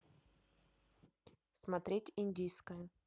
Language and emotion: Russian, neutral